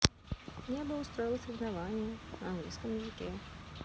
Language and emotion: Russian, neutral